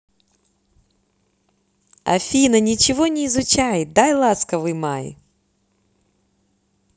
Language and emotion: Russian, positive